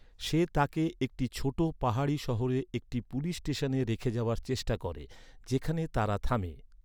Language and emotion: Bengali, neutral